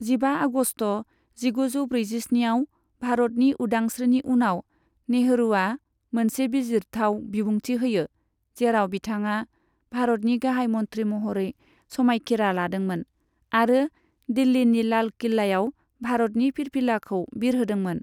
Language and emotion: Bodo, neutral